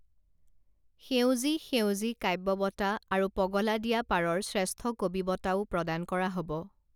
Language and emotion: Assamese, neutral